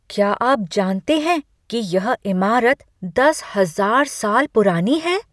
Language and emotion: Hindi, surprised